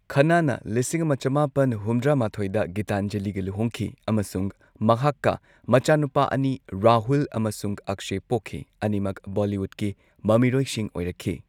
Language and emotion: Manipuri, neutral